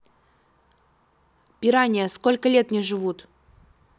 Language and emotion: Russian, neutral